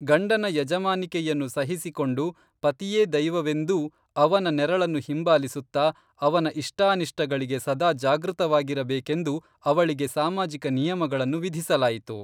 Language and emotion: Kannada, neutral